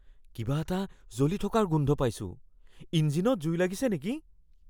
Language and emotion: Assamese, fearful